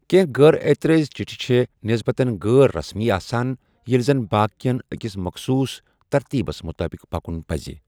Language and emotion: Kashmiri, neutral